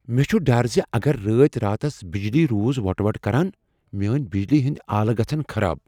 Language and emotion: Kashmiri, fearful